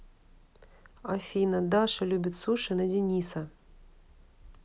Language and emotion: Russian, neutral